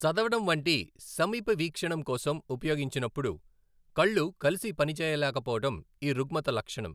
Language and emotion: Telugu, neutral